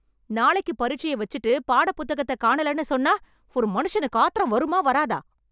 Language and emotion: Tamil, angry